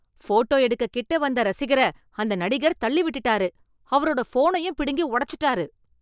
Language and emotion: Tamil, angry